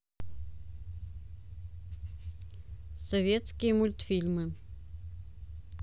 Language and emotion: Russian, neutral